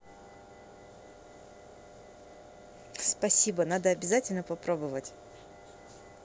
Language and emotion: Russian, positive